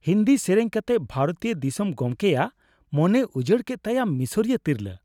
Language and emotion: Santali, happy